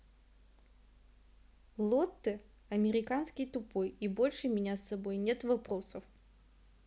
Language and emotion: Russian, neutral